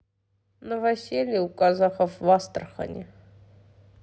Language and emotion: Russian, neutral